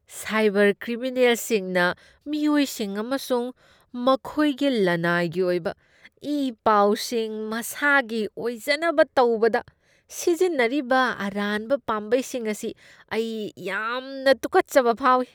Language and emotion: Manipuri, disgusted